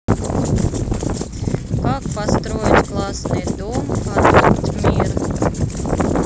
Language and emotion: Russian, neutral